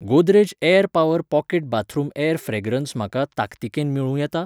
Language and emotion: Goan Konkani, neutral